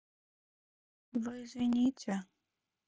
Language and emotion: Russian, sad